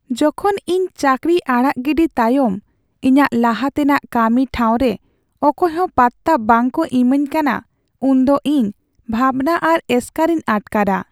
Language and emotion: Santali, sad